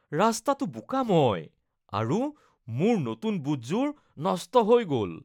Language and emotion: Assamese, disgusted